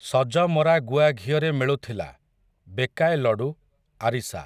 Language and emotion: Odia, neutral